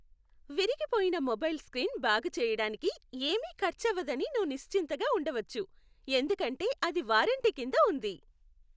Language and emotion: Telugu, happy